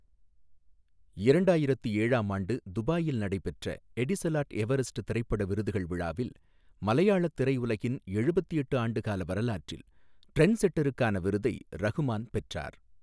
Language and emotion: Tamil, neutral